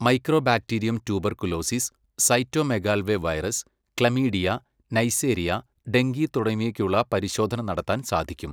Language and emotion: Malayalam, neutral